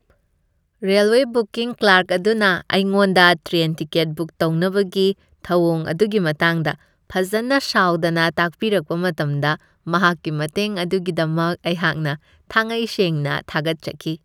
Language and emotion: Manipuri, happy